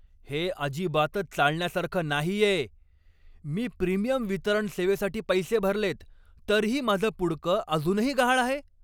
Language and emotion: Marathi, angry